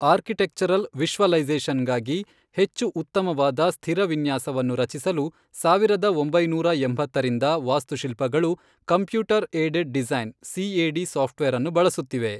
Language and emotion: Kannada, neutral